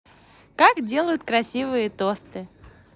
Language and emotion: Russian, positive